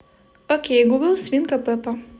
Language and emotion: Russian, positive